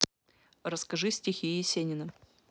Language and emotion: Russian, neutral